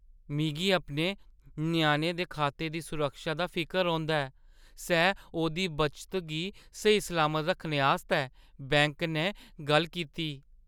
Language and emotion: Dogri, fearful